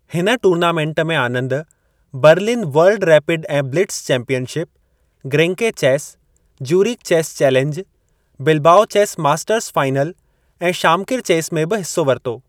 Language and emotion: Sindhi, neutral